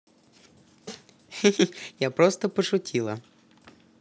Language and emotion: Russian, positive